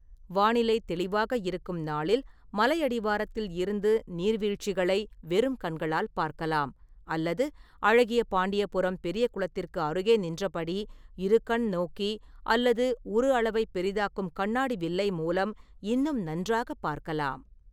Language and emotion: Tamil, neutral